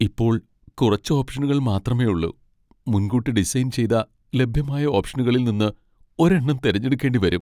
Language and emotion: Malayalam, sad